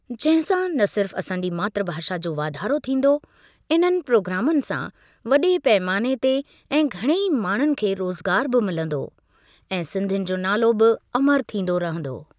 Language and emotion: Sindhi, neutral